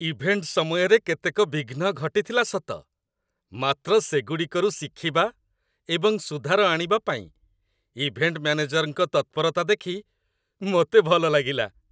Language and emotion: Odia, happy